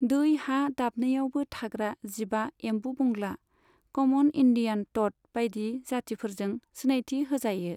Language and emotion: Bodo, neutral